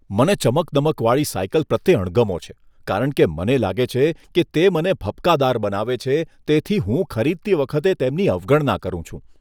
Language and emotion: Gujarati, disgusted